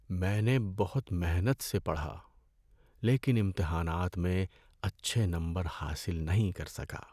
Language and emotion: Urdu, sad